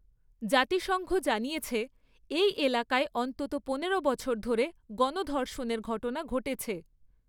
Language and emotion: Bengali, neutral